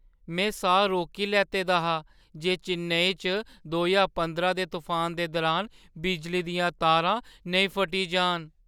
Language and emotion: Dogri, fearful